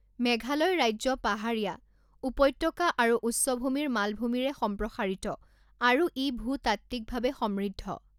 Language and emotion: Assamese, neutral